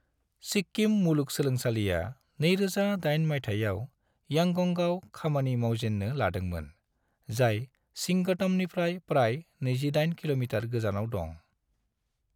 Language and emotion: Bodo, neutral